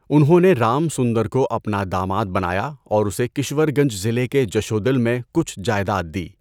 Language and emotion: Urdu, neutral